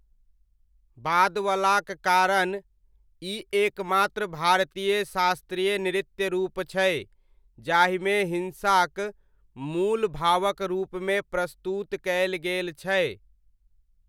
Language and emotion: Maithili, neutral